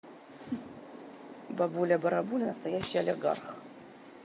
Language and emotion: Russian, positive